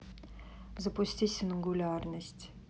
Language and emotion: Russian, neutral